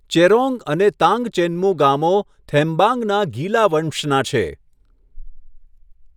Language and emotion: Gujarati, neutral